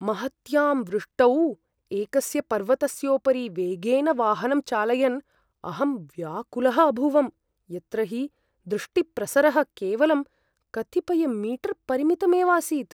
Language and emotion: Sanskrit, fearful